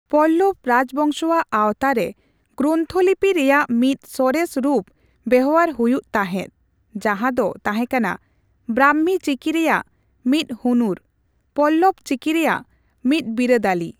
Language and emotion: Santali, neutral